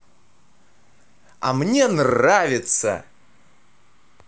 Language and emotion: Russian, positive